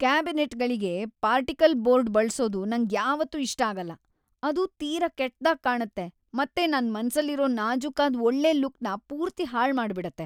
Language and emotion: Kannada, disgusted